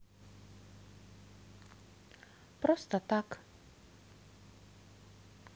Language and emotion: Russian, neutral